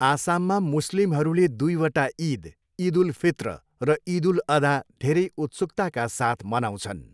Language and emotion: Nepali, neutral